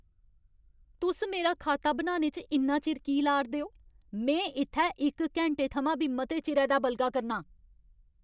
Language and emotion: Dogri, angry